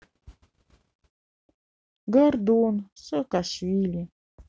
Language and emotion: Russian, sad